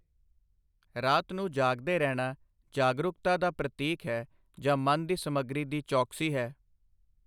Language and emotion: Punjabi, neutral